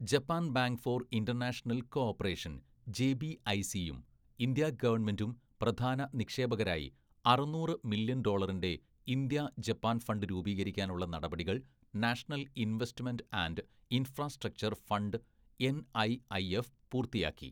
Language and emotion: Malayalam, neutral